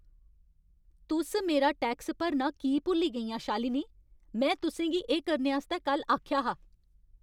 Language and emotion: Dogri, angry